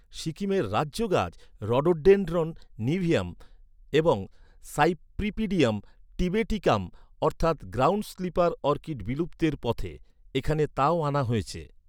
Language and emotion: Bengali, neutral